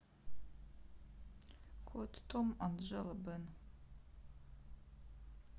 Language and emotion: Russian, neutral